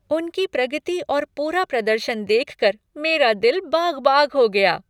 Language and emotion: Hindi, happy